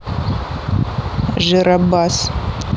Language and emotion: Russian, neutral